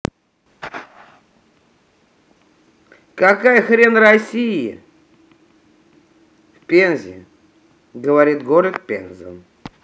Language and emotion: Russian, angry